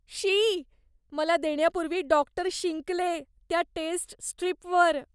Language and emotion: Marathi, disgusted